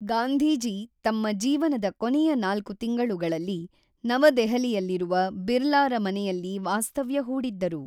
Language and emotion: Kannada, neutral